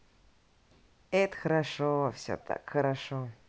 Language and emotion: Russian, positive